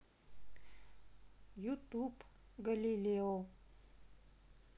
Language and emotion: Russian, neutral